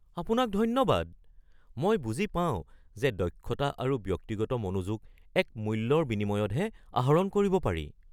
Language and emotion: Assamese, surprised